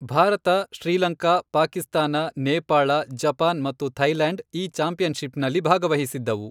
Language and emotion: Kannada, neutral